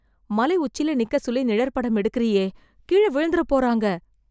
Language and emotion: Tamil, fearful